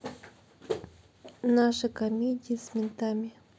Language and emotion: Russian, neutral